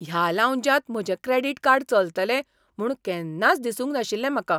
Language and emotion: Goan Konkani, surprised